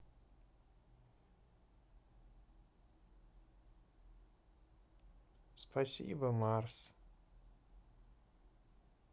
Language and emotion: Russian, neutral